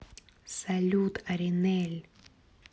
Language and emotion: Russian, neutral